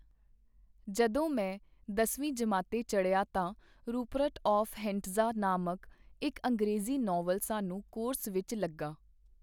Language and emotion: Punjabi, neutral